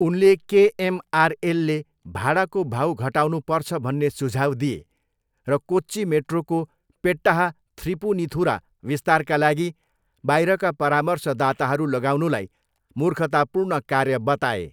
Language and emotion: Nepali, neutral